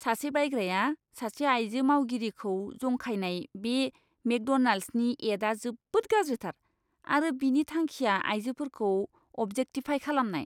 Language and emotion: Bodo, disgusted